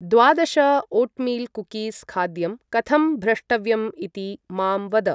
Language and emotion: Sanskrit, neutral